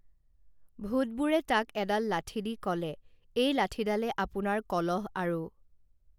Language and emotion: Assamese, neutral